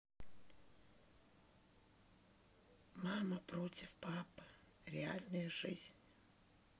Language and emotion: Russian, sad